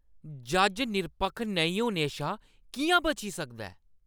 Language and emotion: Dogri, angry